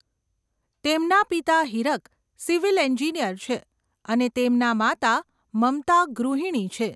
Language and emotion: Gujarati, neutral